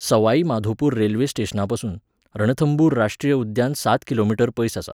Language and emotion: Goan Konkani, neutral